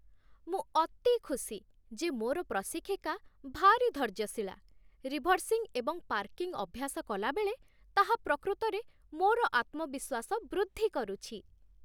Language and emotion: Odia, happy